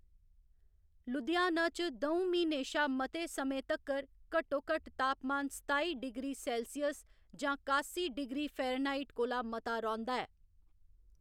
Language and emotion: Dogri, neutral